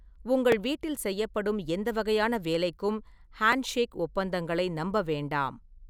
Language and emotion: Tamil, neutral